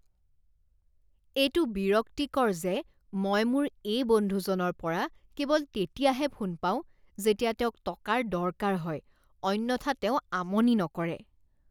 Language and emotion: Assamese, disgusted